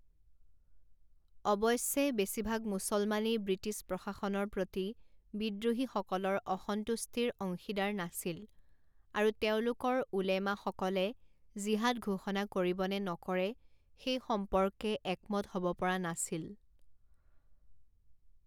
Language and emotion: Assamese, neutral